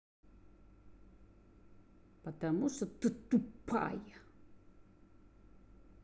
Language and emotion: Russian, angry